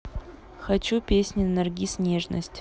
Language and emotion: Russian, neutral